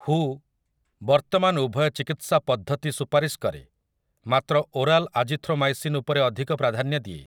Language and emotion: Odia, neutral